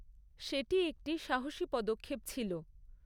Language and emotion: Bengali, neutral